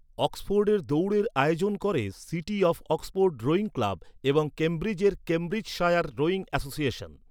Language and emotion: Bengali, neutral